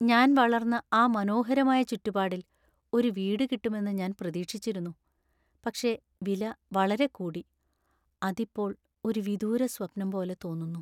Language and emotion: Malayalam, sad